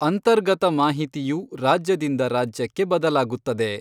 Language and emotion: Kannada, neutral